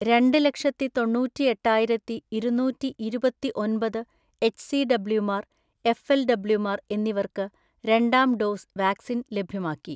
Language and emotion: Malayalam, neutral